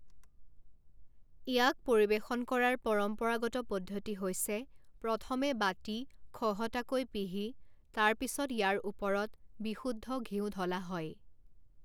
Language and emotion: Assamese, neutral